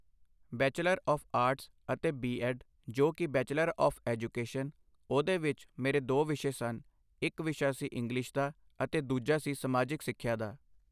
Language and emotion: Punjabi, neutral